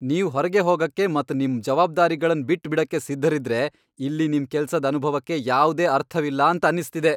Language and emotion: Kannada, angry